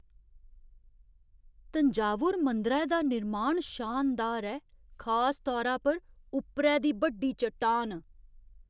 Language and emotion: Dogri, surprised